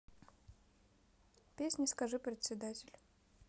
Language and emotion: Russian, neutral